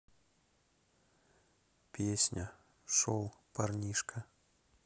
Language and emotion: Russian, neutral